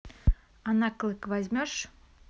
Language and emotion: Russian, neutral